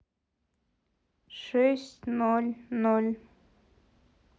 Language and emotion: Russian, neutral